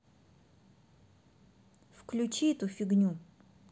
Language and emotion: Russian, angry